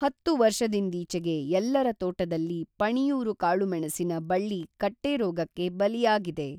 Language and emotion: Kannada, neutral